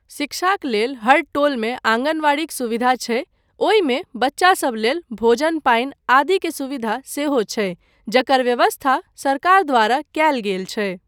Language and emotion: Maithili, neutral